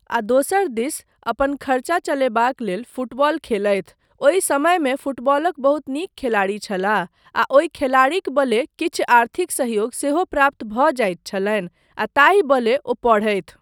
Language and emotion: Maithili, neutral